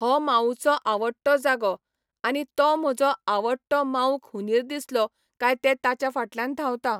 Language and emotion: Goan Konkani, neutral